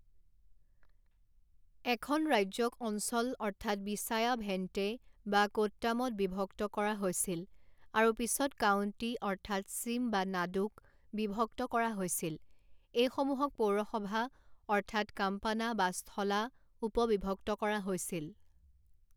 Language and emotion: Assamese, neutral